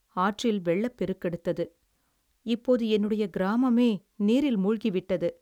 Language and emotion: Tamil, sad